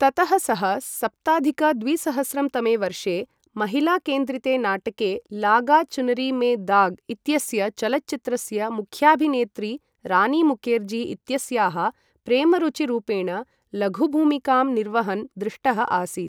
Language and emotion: Sanskrit, neutral